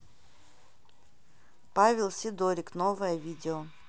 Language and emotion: Russian, neutral